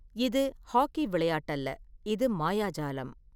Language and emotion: Tamil, neutral